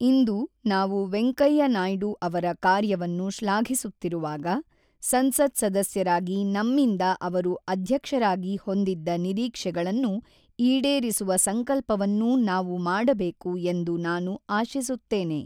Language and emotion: Kannada, neutral